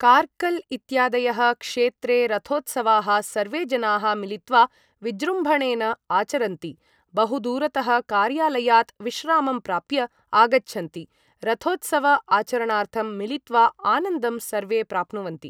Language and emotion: Sanskrit, neutral